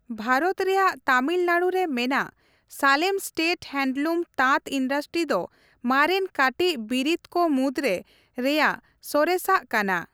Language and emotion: Santali, neutral